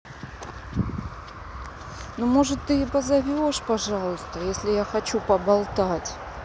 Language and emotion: Russian, neutral